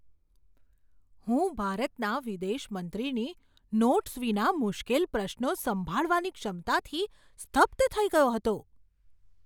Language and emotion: Gujarati, surprised